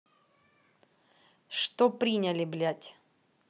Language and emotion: Russian, angry